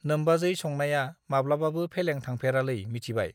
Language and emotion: Bodo, neutral